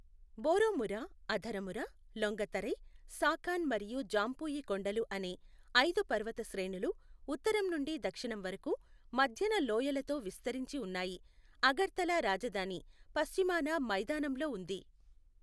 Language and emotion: Telugu, neutral